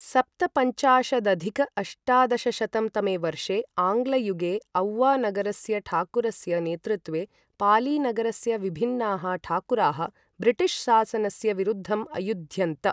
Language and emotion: Sanskrit, neutral